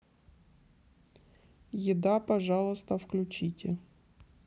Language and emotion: Russian, neutral